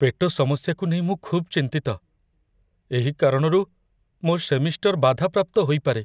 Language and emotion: Odia, fearful